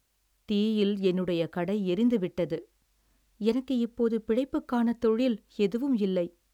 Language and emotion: Tamil, sad